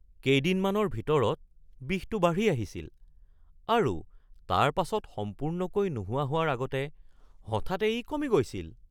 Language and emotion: Assamese, surprised